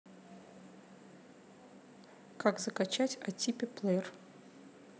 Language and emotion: Russian, neutral